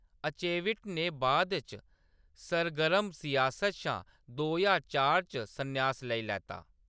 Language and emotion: Dogri, neutral